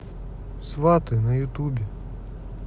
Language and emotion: Russian, neutral